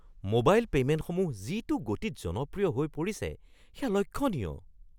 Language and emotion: Assamese, surprised